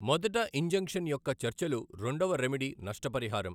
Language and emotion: Telugu, neutral